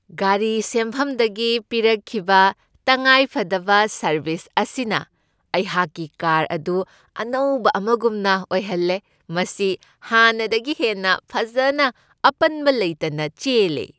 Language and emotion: Manipuri, happy